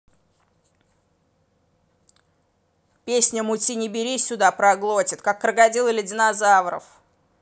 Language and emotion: Russian, angry